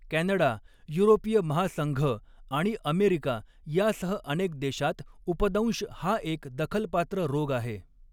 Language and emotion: Marathi, neutral